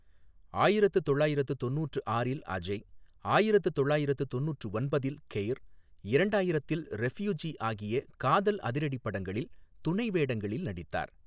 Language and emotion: Tamil, neutral